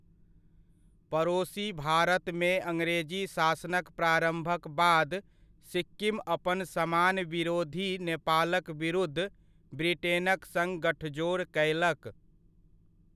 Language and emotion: Maithili, neutral